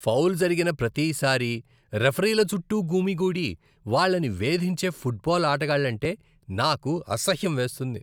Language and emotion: Telugu, disgusted